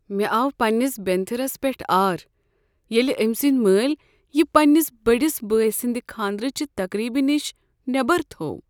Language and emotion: Kashmiri, sad